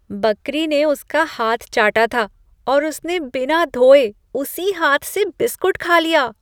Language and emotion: Hindi, disgusted